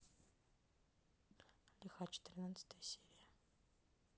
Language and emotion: Russian, neutral